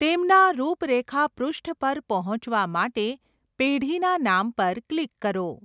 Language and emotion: Gujarati, neutral